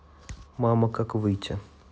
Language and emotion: Russian, neutral